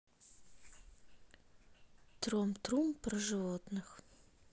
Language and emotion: Russian, neutral